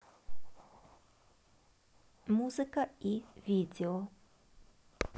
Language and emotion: Russian, neutral